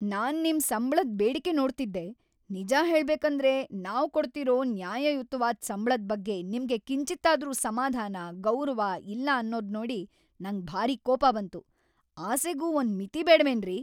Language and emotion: Kannada, angry